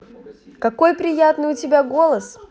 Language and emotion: Russian, positive